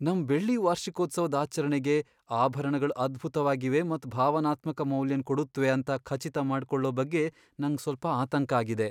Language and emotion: Kannada, fearful